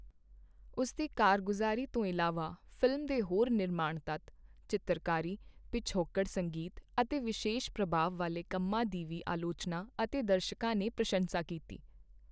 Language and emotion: Punjabi, neutral